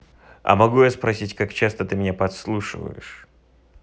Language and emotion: Russian, neutral